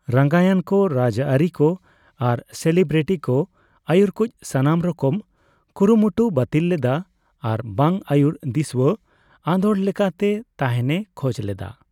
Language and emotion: Santali, neutral